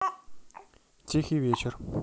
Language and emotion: Russian, neutral